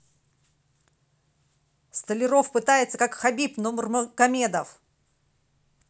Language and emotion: Russian, positive